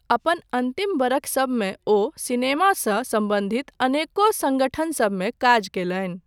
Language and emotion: Maithili, neutral